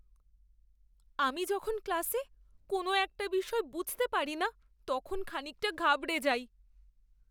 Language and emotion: Bengali, fearful